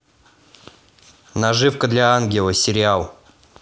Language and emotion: Russian, neutral